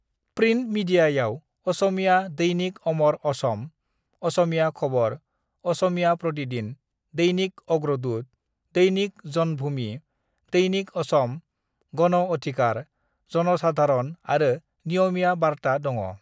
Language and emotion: Bodo, neutral